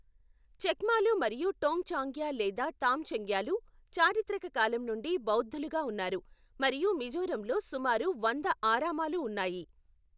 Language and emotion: Telugu, neutral